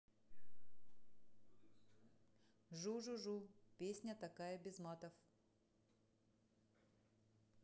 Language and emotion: Russian, neutral